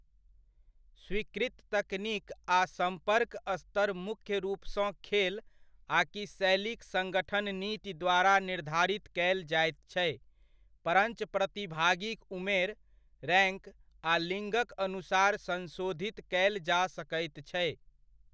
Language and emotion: Maithili, neutral